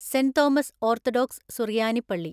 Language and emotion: Malayalam, neutral